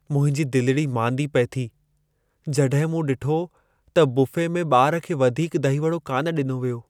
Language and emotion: Sindhi, sad